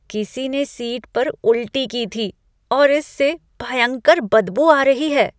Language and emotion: Hindi, disgusted